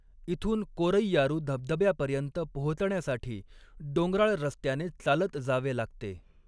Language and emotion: Marathi, neutral